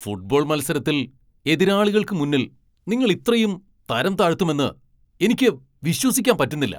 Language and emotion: Malayalam, angry